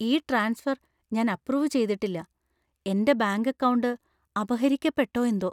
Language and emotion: Malayalam, fearful